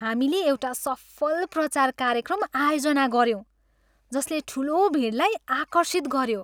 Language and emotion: Nepali, happy